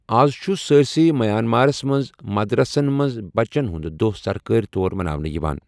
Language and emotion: Kashmiri, neutral